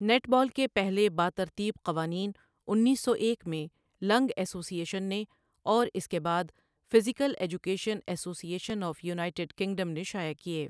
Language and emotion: Urdu, neutral